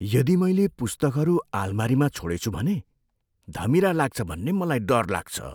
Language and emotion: Nepali, fearful